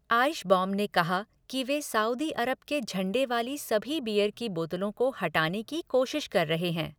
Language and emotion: Hindi, neutral